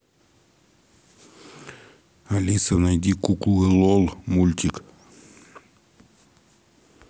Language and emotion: Russian, neutral